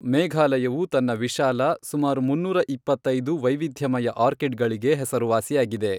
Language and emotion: Kannada, neutral